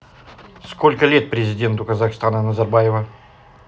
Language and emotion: Russian, neutral